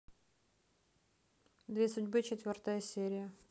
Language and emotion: Russian, neutral